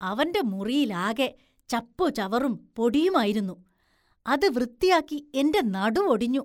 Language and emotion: Malayalam, disgusted